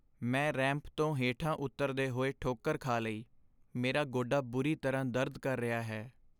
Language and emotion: Punjabi, sad